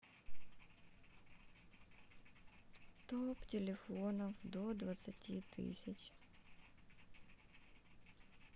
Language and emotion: Russian, sad